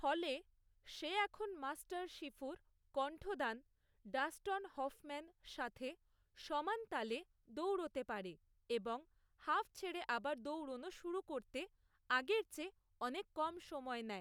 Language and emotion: Bengali, neutral